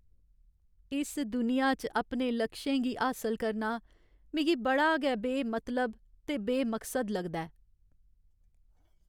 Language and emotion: Dogri, sad